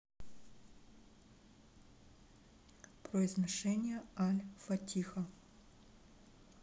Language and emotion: Russian, neutral